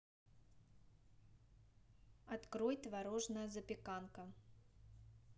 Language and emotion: Russian, neutral